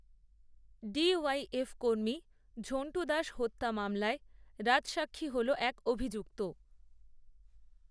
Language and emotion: Bengali, neutral